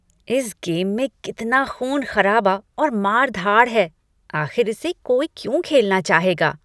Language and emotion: Hindi, disgusted